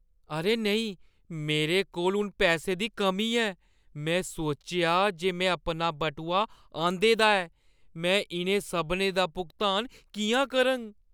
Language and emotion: Dogri, fearful